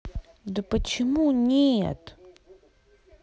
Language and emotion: Russian, angry